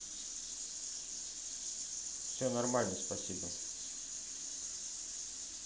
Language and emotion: Russian, neutral